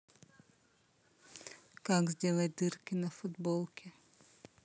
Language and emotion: Russian, neutral